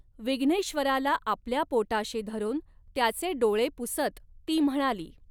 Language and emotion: Marathi, neutral